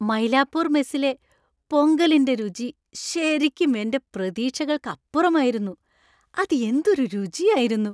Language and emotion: Malayalam, happy